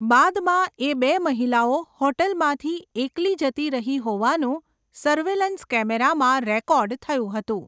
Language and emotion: Gujarati, neutral